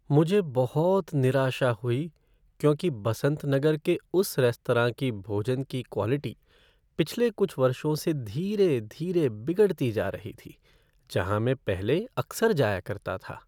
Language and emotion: Hindi, sad